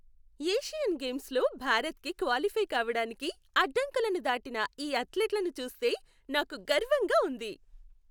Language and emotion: Telugu, happy